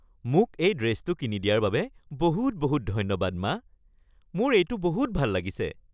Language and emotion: Assamese, happy